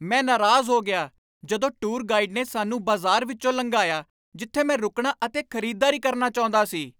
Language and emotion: Punjabi, angry